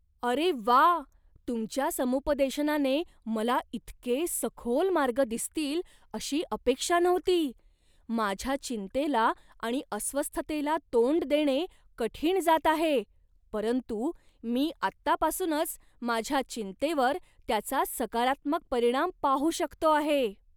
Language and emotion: Marathi, surprised